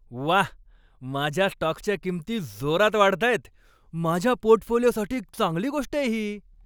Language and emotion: Marathi, happy